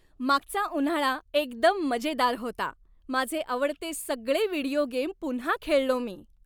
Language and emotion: Marathi, happy